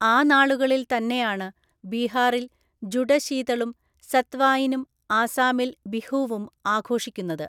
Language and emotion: Malayalam, neutral